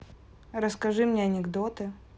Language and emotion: Russian, neutral